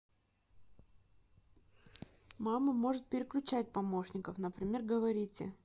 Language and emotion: Russian, neutral